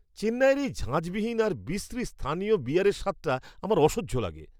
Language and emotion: Bengali, disgusted